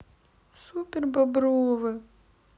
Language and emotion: Russian, sad